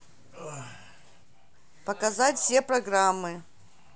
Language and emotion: Russian, neutral